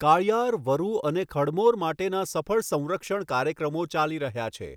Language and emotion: Gujarati, neutral